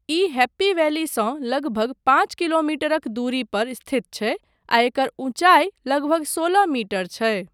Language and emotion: Maithili, neutral